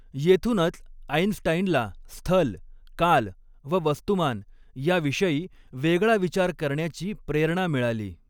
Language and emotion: Marathi, neutral